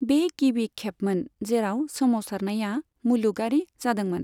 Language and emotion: Bodo, neutral